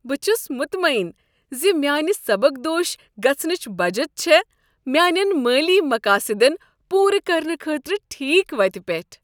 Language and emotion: Kashmiri, happy